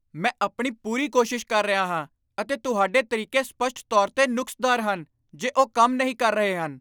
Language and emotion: Punjabi, angry